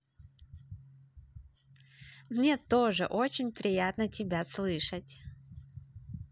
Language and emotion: Russian, positive